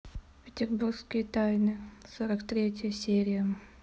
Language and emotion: Russian, neutral